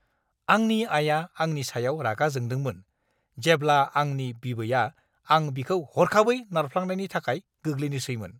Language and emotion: Bodo, angry